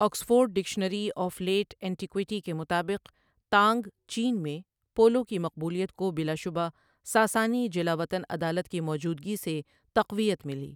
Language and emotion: Urdu, neutral